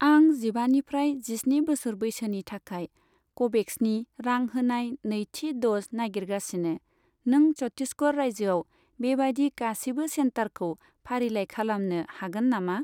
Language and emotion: Bodo, neutral